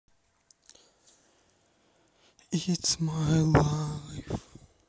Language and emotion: Russian, neutral